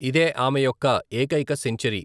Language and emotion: Telugu, neutral